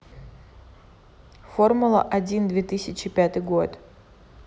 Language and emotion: Russian, neutral